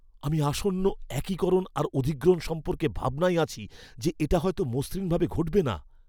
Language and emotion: Bengali, fearful